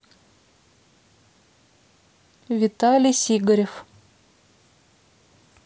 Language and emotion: Russian, neutral